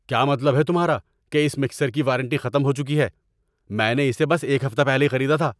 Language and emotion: Urdu, angry